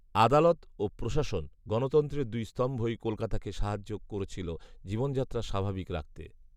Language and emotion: Bengali, neutral